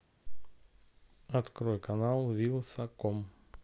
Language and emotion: Russian, neutral